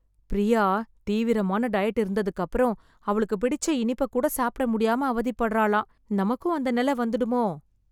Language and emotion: Tamil, fearful